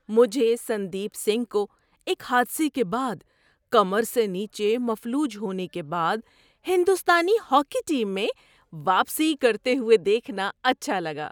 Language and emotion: Urdu, happy